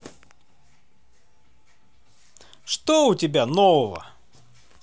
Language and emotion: Russian, positive